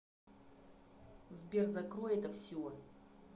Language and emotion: Russian, angry